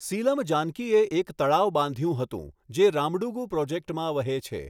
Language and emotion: Gujarati, neutral